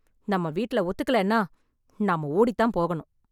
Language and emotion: Tamil, angry